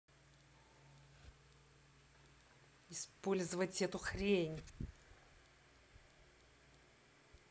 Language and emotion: Russian, angry